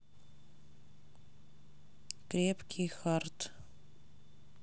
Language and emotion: Russian, neutral